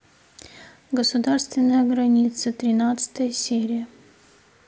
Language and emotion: Russian, neutral